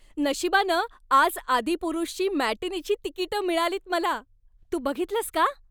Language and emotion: Marathi, happy